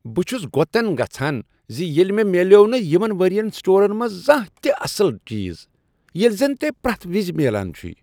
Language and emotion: Kashmiri, disgusted